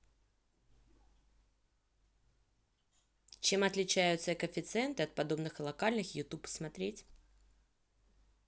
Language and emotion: Russian, neutral